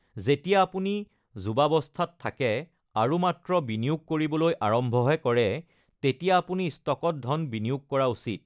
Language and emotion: Assamese, neutral